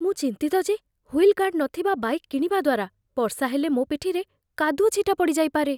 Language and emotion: Odia, fearful